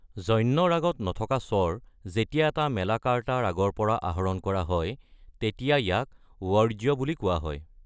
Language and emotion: Assamese, neutral